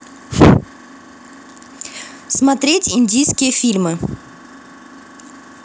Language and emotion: Russian, neutral